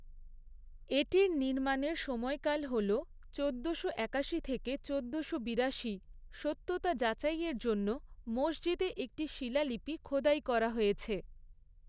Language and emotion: Bengali, neutral